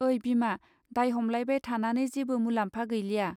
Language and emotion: Bodo, neutral